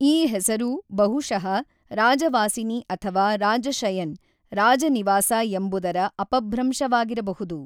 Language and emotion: Kannada, neutral